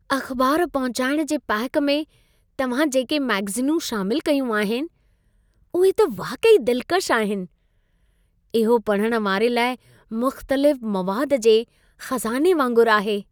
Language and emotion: Sindhi, happy